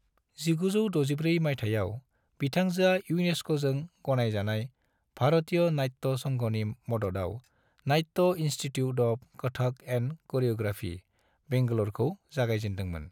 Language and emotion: Bodo, neutral